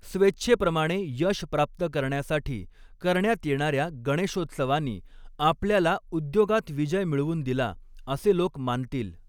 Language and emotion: Marathi, neutral